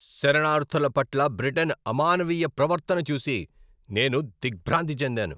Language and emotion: Telugu, angry